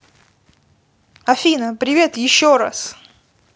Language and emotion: Russian, positive